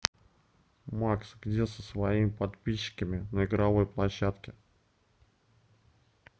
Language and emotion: Russian, neutral